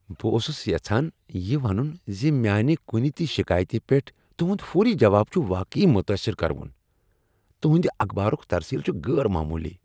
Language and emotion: Kashmiri, happy